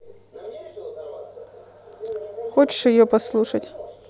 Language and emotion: Russian, neutral